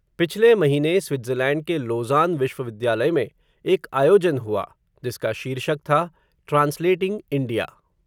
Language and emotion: Hindi, neutral